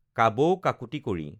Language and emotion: Assamese, neutral